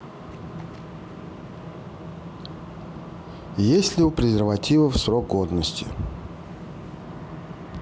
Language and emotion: Russian, neutral